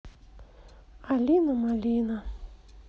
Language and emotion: Russian, sad